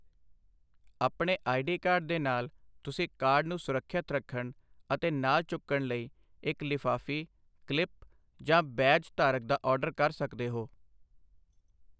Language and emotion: Punjabi, neutral